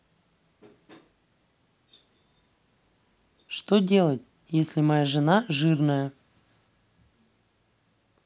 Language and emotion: Russian, neutral